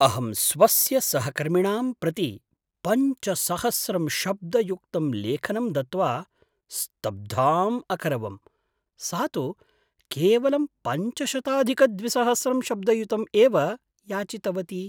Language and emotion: Sanskrit, surprised